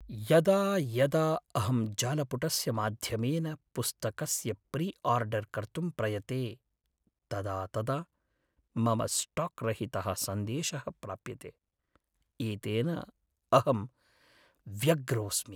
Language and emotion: Sanskrit, sad